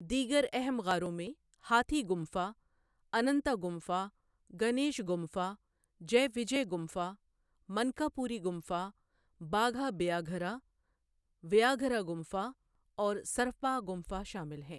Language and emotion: Urdu, neutral